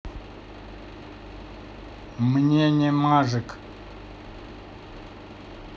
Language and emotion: Russian, neutral